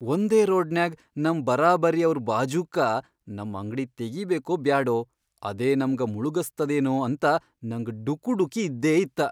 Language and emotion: Kannada, fearful